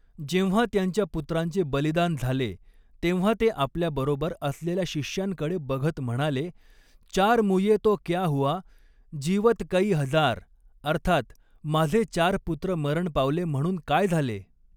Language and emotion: Marathi, neutral